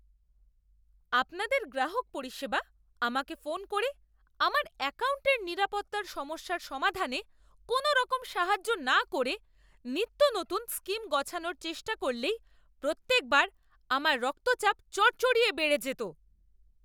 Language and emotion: Bengali, angry